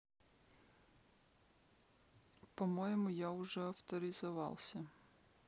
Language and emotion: Russian, neutral